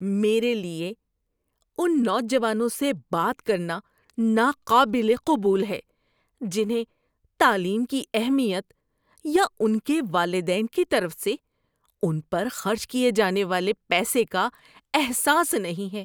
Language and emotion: Urdu, disgusted